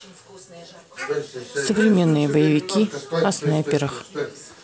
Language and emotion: Russian, neutral